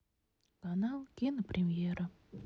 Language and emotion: Russian, sad